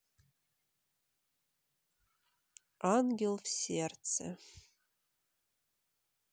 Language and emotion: Russian, neutral